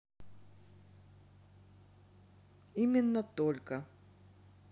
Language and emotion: Russian, neutral